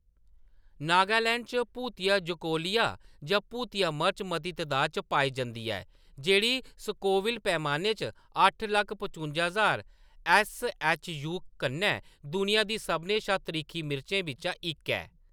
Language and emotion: Dogri, neutral